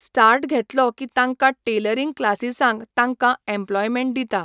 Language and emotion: Goan Konkani, neutral